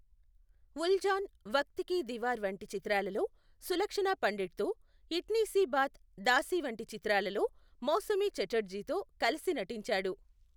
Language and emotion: Telugu, neutral